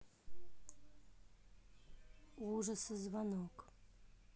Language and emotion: Russian, neutral